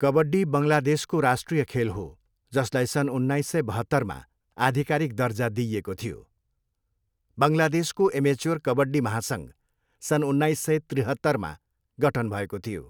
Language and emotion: Nepali, neutral